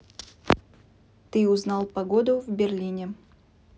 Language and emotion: Russian, neutral